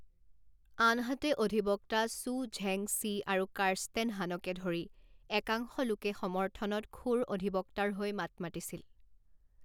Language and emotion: Assamese, neutral